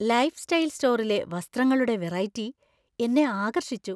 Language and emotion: Malayalam, surprised